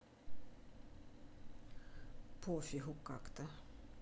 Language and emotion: Russian, neutral